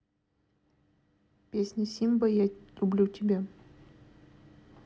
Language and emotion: Russian, neutral